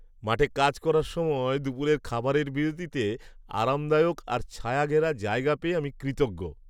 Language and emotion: Bengali, happy